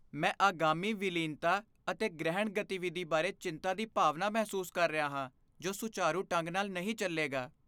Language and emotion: Punjabi, fearful